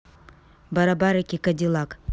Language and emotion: Russian, neutral